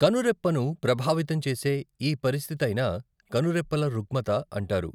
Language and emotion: Telugu, neutral